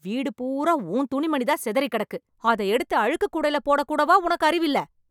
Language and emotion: Tamil, angry